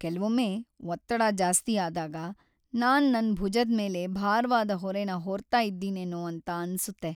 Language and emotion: Kannada, sad